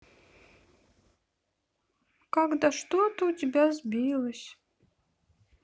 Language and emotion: Russian, sad